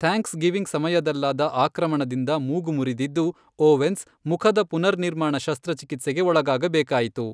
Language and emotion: Kannada, neutral